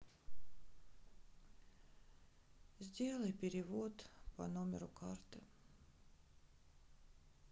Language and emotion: Russian, sad